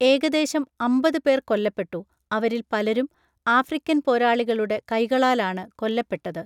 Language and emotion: Malayalam, neutral